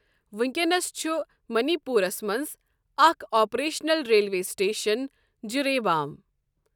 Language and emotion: Kashmiri, neutral